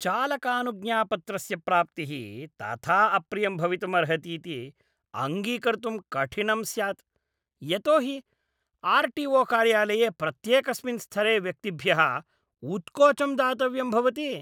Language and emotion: Sanskrit, disgusted